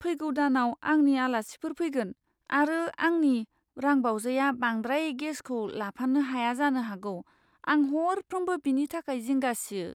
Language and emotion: Bodo, fearful